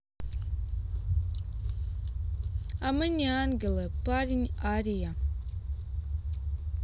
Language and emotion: Russian, neutral